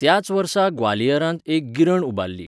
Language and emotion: Goan Konkani, neutral